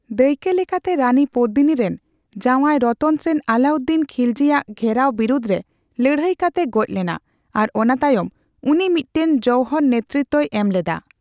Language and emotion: Santali, neutral